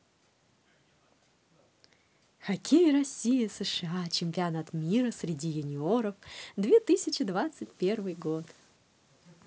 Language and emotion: Russian, positive